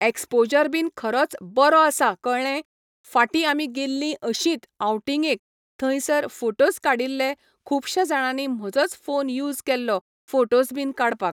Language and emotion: Goan Konkani, neutral